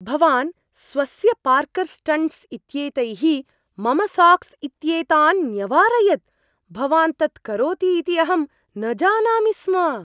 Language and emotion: Sanskrit, surprised